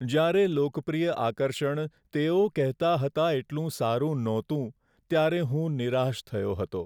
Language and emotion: Gujarati, sad